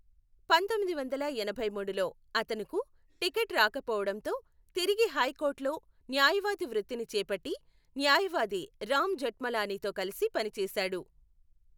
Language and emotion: Telugu, neutral